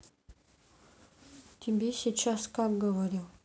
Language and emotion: Russian, sad